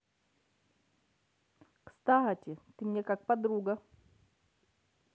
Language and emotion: Russian, positive